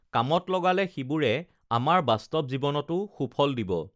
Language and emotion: Assamese, neutral